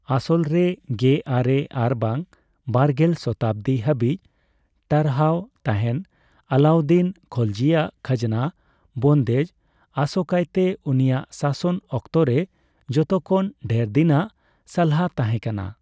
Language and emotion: Santali, neutral